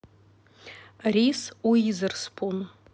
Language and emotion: Russian, neutral